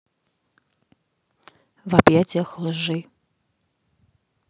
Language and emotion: Russian, neutral